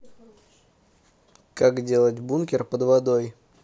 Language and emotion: Russian, neutral